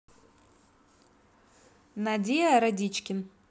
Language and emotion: Russian, neutral